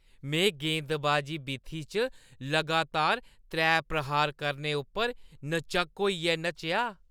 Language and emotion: Dogri, happy